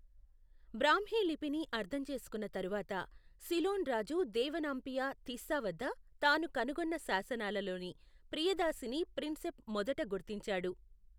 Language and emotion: Telugu, neutral